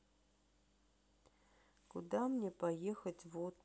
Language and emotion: Russian, sad